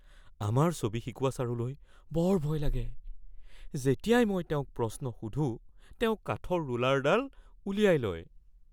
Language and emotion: Assamese, fearful